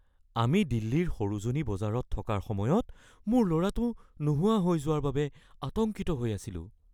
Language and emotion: Assamese, fearful